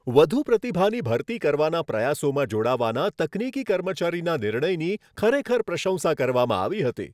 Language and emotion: Gujarati, happy